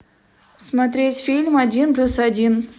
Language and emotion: Russian, neutral